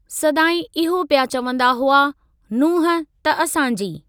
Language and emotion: Sindhi, neutral